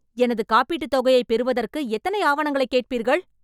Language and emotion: Tamil, angry